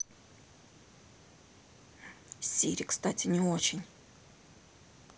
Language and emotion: Russian, neutral